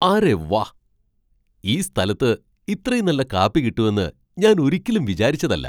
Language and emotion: Malayalam, surprised